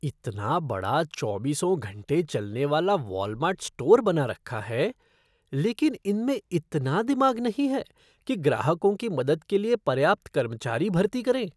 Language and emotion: Hindi, disgusted